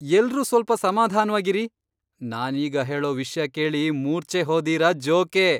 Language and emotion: Kannada, surprised